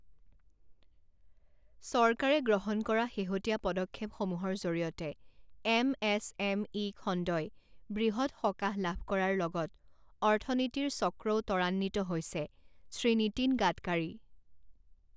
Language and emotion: Assamese, neutral